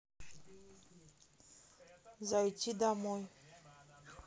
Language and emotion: Russian, neutral